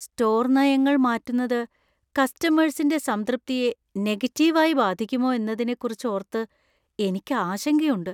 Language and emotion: Malayalam, fearful